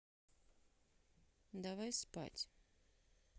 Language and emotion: Russian, neutral